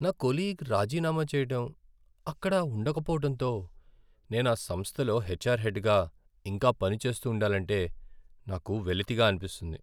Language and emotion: Telugu, sad